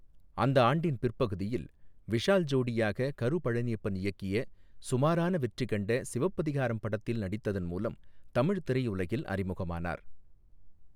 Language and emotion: Tamil, neutral